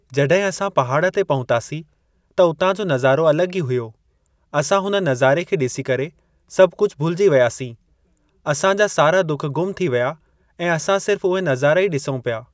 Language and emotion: Sindhi, neutral